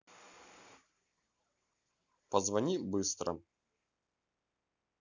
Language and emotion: Russian, neutral